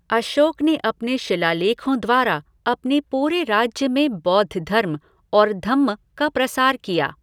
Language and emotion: Hindi, neutral